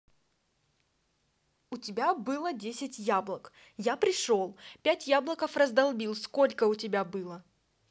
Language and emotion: Russian, angry